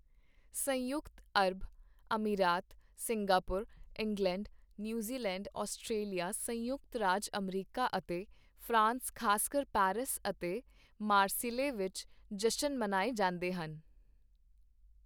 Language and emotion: Punjabi, neutral